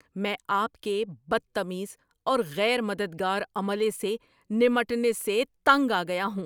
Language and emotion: Urdu, angry